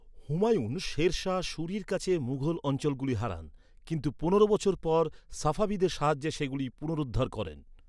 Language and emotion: Bengali, neutral